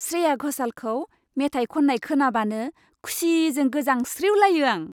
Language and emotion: Bodo, happy